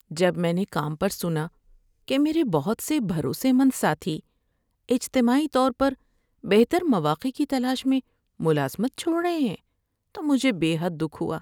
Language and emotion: Urdu, sad